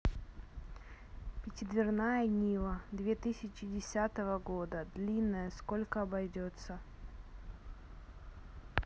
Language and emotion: Russian, neutral